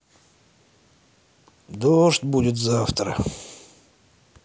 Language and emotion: Russian, sad